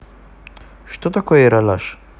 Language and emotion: Russian, neutral